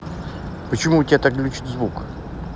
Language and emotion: Russian, neutral